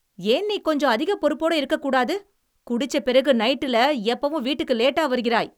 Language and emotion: Tamil, angry